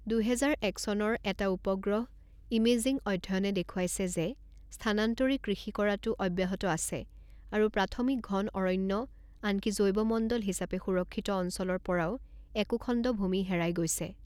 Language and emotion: Assamese, neutral